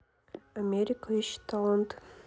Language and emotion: Russian, neutral